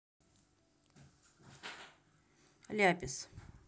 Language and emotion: Russian, neutral